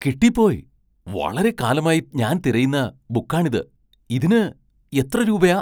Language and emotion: Malayalam, surprised